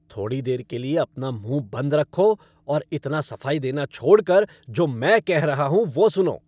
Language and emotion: Hindi, angry